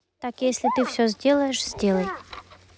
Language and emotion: Russian, neutral